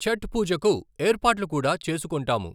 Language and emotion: Telugu, neutral